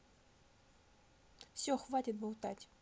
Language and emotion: Russian, angry